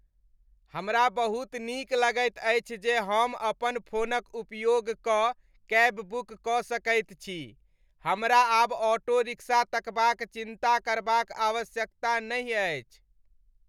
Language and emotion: Maithili, happy